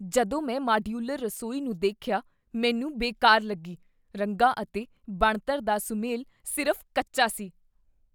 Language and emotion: Punjabi, disgusted